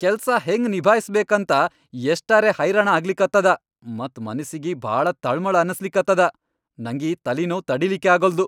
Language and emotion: Kannada, angry